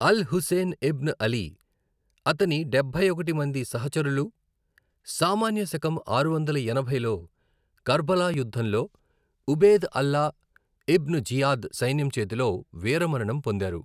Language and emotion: Telugu, neutral